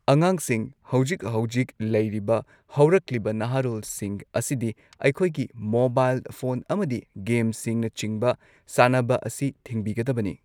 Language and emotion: Manipuri, neutral